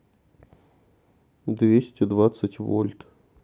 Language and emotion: Russian, neutral